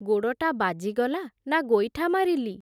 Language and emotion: Odia, neutral